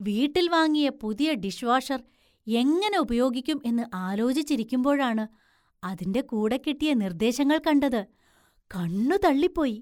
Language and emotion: Malayalam, surprised